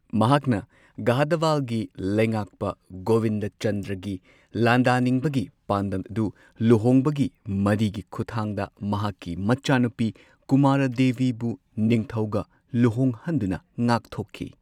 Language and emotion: Manipuri, neutral